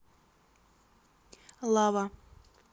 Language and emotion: Russian, neutral